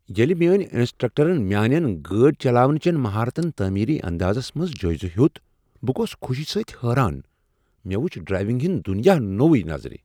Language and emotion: Kashmiri, surprised